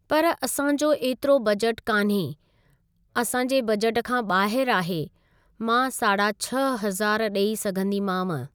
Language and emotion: Sindhi, neutral